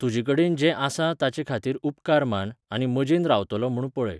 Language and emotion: Goan Konkani, neutral